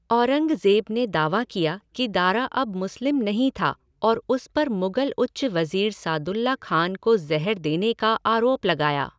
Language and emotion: Hindi, neutral